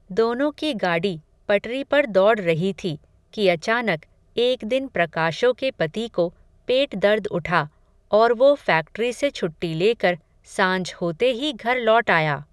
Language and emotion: Hindi, neutral